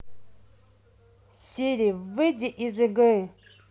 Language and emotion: Russian, angry